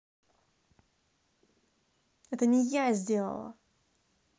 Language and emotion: Russian, angry